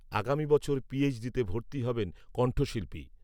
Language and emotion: Bengali, neutral